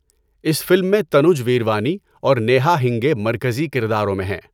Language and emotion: Urdu, neutral